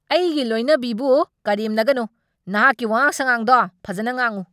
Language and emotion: Manipuri, angry